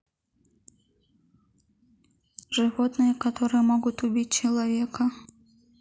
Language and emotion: Russian, sad